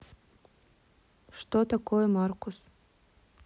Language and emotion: Russian, neutral